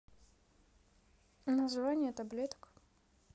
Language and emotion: Russian, neutral